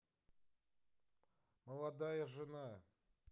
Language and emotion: Russian, neutral